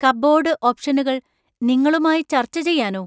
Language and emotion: Malayalam, surprised